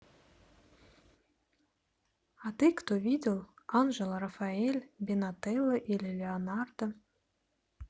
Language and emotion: Russian, neutral